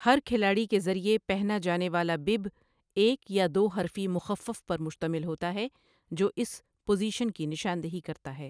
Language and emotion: Urdu, neutral